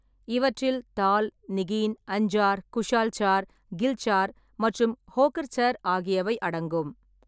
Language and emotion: Tamil, neutral